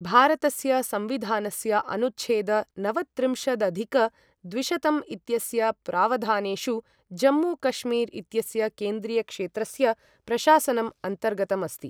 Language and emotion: Sanskrit, neutral